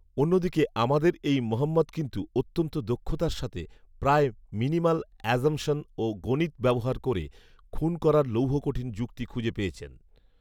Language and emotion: Bengali, neutral